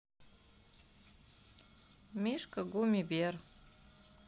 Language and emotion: Russian, neutral